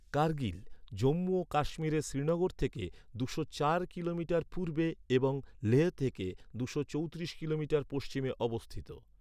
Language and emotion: Bengali, neutral